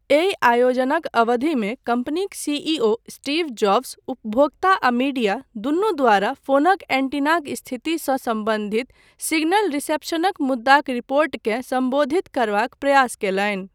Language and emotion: Maithili, neutral